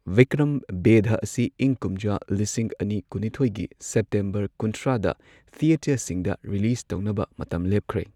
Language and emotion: Manipuri, neutral